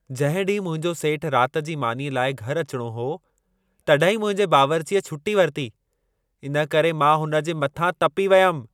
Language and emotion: Sindhi, angry